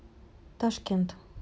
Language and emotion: Russian, neutral